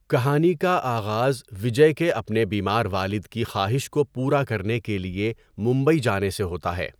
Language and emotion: Urdu, neutral